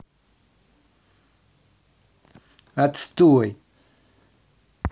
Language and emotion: Russian, angry